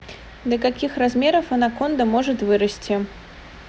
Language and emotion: Russian, neutral